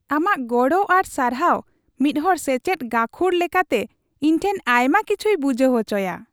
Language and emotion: Santali, happy